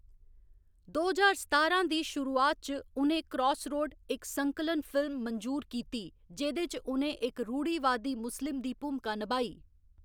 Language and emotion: Dogri, neutral